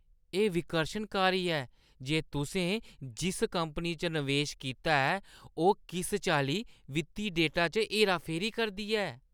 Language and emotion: Dogri, disgusted